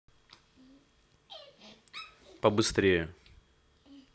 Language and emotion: Russian, neutral